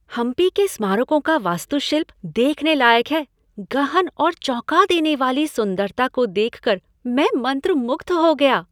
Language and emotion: Hindi, happy